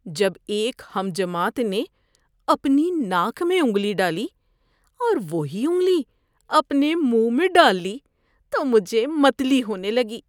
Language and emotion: Urdu, disgusted